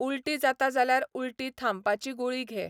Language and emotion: Goan Konkani, neutral